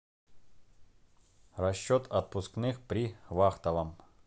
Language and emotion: Russian, neutral